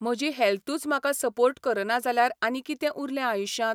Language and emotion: Goan Konkani, neutral